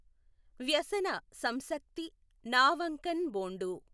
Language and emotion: Telugu, neutral